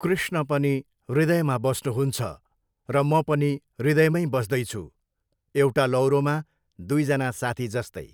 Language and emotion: Nepali, neutral